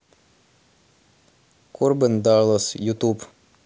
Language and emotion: Russian, neutral